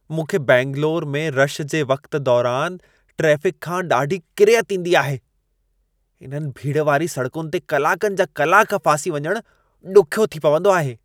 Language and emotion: Sindhi, disgusted